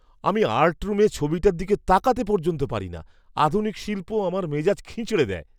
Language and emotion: Bengali, disgusted